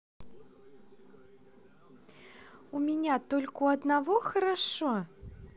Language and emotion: Russian, neutral